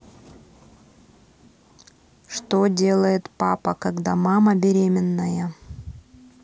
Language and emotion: Russian, neutral